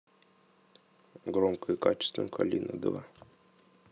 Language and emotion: Russian, neutral